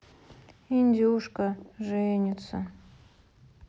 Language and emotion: Russian, sad